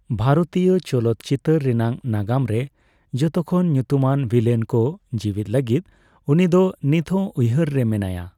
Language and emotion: Santali, neutral